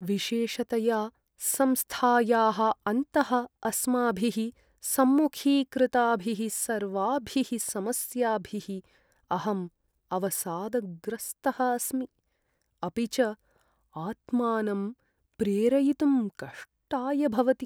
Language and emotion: Sanskrit, sad